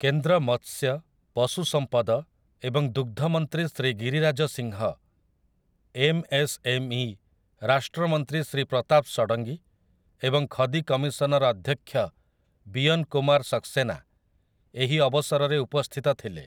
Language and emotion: Odia, neutral